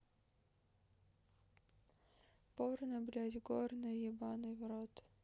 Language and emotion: Russian, sad